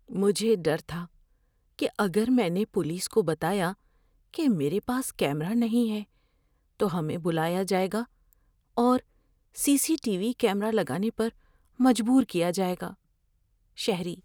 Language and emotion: Urdu, fearful